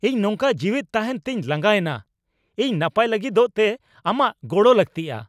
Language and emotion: Santali, angry